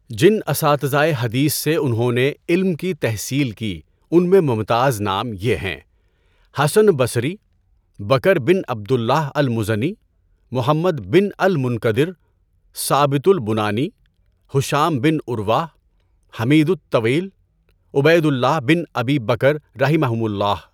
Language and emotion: Urdu, neutral